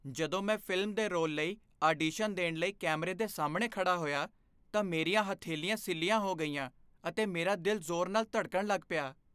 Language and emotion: Punjabi, fearful